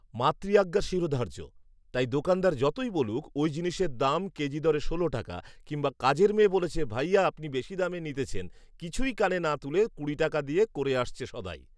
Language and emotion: Bengali, neutral